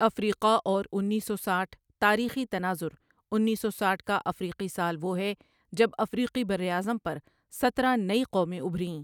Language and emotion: Urdu, neutral